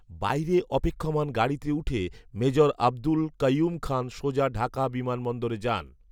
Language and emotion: Bengali, neutral